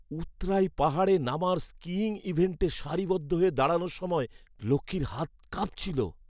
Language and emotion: Bengali, fearful